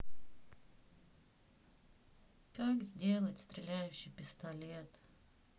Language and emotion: Russian, sad